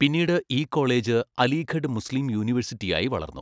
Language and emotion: Malayalam, neutral